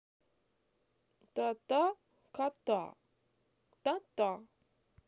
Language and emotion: Russian, positive